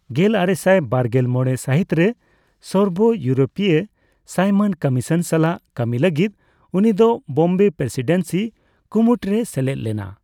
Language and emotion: Santali, neutral